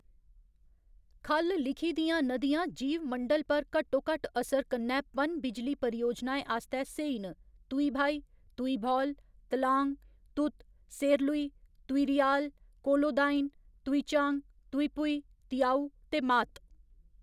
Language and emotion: Dogri, neutral